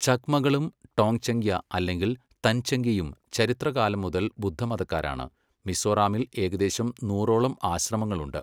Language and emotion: Malayalam, neutral